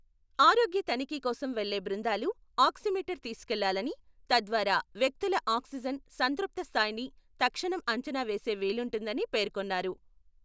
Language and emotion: Telugu, neutral